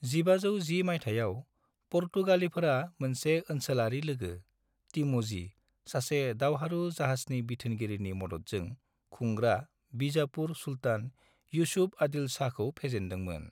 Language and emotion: Bodo, neutral